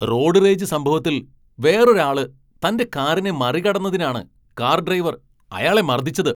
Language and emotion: Malayalam, angry